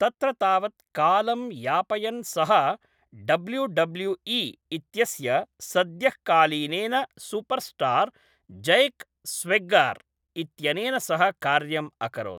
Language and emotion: Sanskrit, neutral